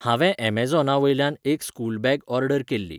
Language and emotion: Goan Konkani, neutral